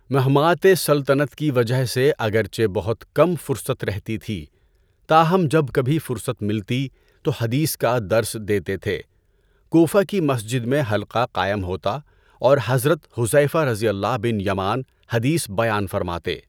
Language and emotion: Urdu, neutral